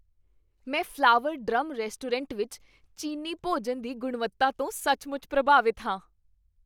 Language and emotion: Punjabi, happy